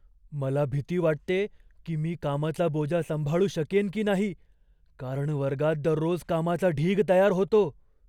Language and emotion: Marathi, fearful